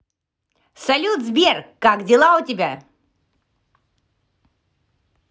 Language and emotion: Russian, positive